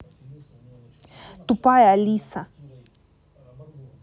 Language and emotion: Russian, angry